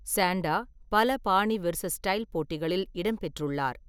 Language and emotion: Tamil, neutral